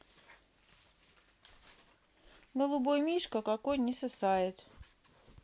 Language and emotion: Russian, sad